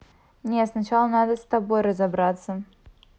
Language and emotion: Russian, neutral